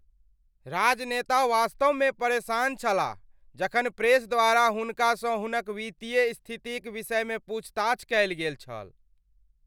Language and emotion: Maithili, angry